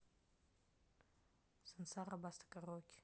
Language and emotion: Russian, neutral